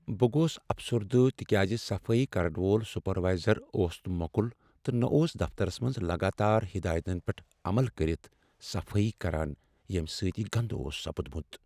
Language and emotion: Kashmiri, sad